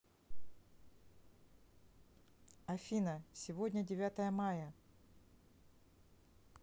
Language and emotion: Russian, neutral